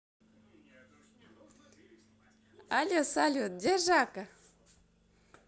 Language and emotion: Russian, positive